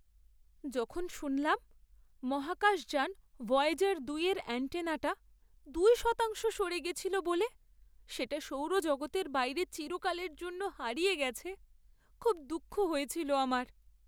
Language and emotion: Bengali, sad